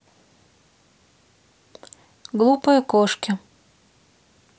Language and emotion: Russian, neutral